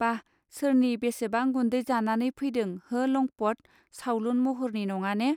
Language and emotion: Bodo, neutral